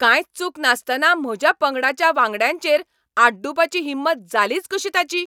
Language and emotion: Goan Konkani, angry